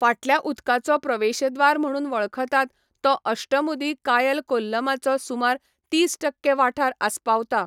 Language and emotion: Goan Konkani, neutral